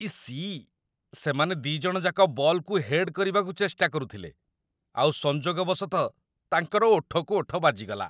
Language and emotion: Odia, disgusted